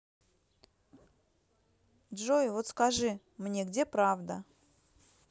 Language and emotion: Russian, neutral